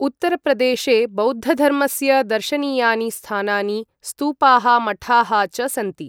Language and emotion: Sanskrit, neutral